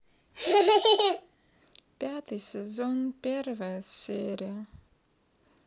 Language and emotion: Russian, sad